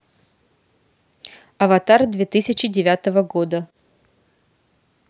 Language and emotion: Russian, neutral